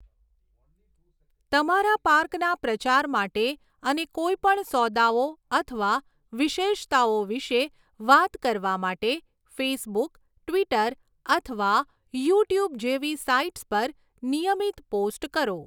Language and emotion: Gujarati, neutral